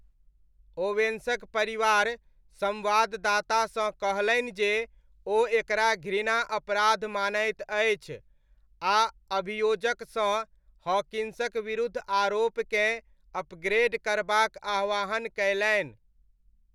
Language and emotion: Maithili, neutral